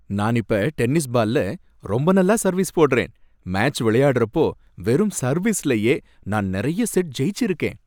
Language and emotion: Tamil, happy